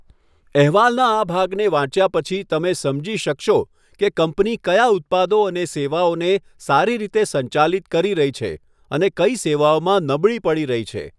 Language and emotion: Gujarati, neutral